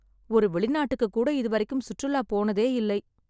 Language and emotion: Tamil, sad